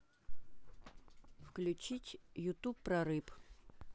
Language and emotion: Russian, neutral